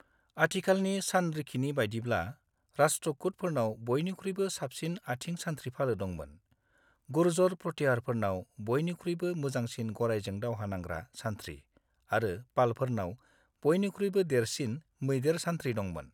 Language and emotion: Bodo, neutral